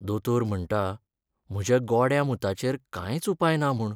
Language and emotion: Goan Konkani, sad